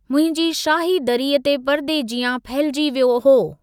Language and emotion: Sindhi, neutral